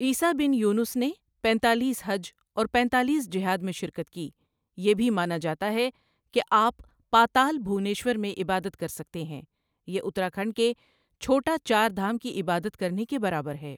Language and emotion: Urdu, neutral